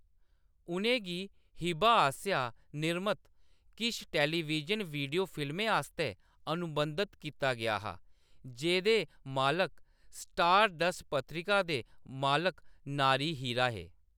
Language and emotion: Dogri, neutral